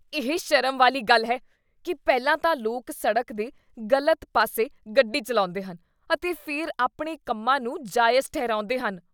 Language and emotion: Punjabi, disgusted